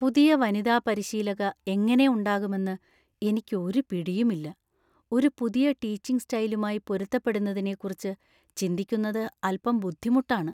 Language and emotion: Malayalam, fearful